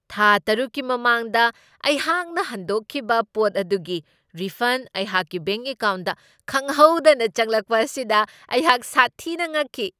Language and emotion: Manipuri, surprised